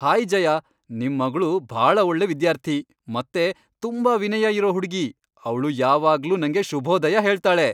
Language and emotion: Kannada, happy